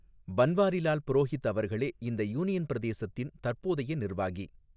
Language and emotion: Tamil, neutral